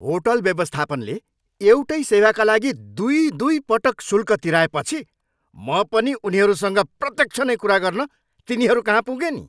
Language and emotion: Nepali, angry